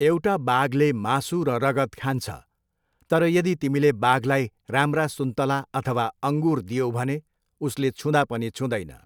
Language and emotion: Nepali, neutral